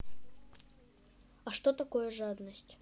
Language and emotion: Russian, neutral